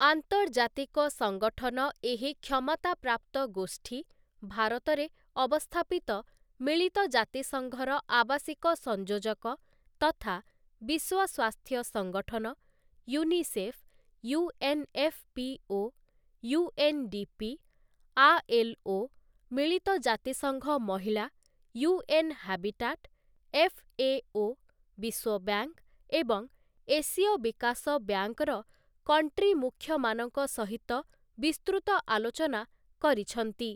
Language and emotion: Odia, neutral